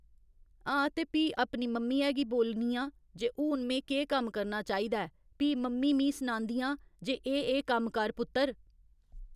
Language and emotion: Dogri, neutral